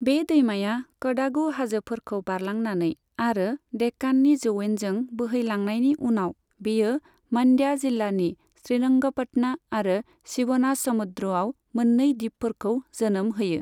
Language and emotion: Bodo, neutral